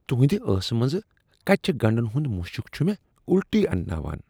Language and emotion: Kashmiri, disgusted